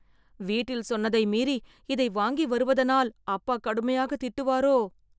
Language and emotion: Tamil, fearful